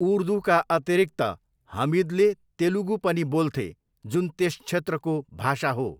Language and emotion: Nepali, neutral